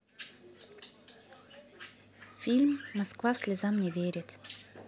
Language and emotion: Russian, neutral